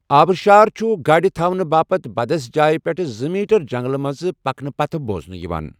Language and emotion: Kashmiri, neutral